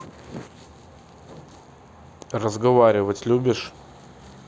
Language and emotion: Russian, neutral